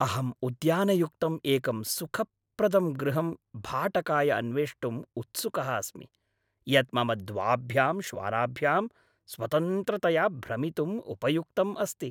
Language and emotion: Sanskrit, happy